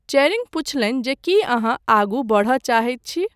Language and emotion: Maithili, neutral